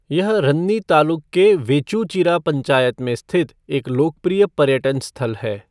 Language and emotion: Hindi, neutral